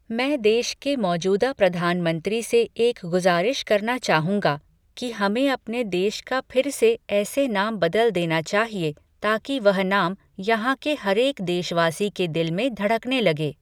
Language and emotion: Hindi, neutral